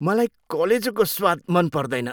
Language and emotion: Nepali, disgusted